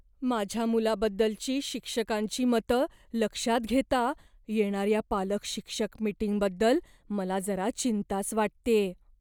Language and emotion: Marathi, fearful